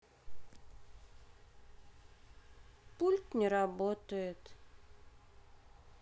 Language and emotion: Russian, sad